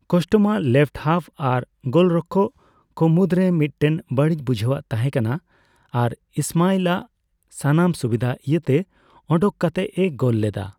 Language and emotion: Santali, neutral